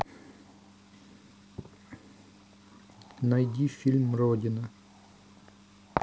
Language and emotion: Russian, neutral